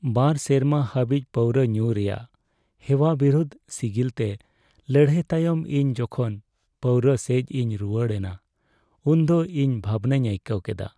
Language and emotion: Santali, sad